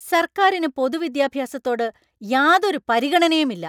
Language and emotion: Malayalam, angry